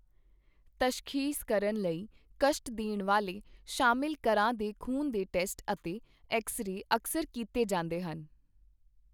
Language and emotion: Punjabi, neutral